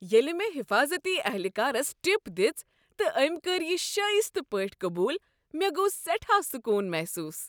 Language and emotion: Kashmiri, happy